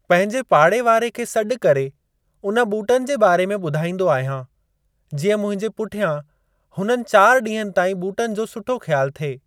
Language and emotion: Sindhi, neutral